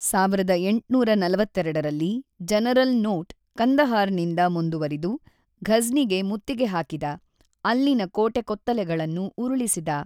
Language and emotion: Kannada, neutral